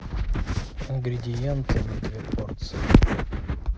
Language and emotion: Russian, neutral